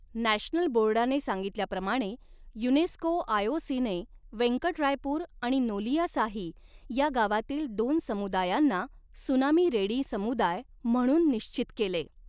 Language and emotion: Marathi, neutral